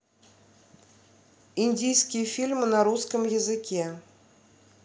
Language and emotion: Russian, neutral